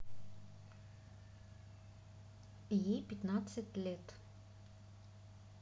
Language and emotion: Russian, neutral